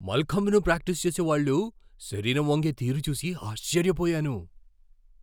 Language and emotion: Telugu, surprised